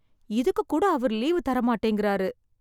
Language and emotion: Tamil, sad